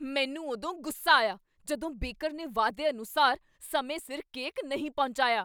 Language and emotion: Punjabi, angry